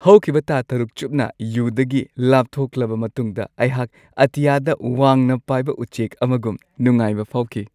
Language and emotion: Manipuri, happy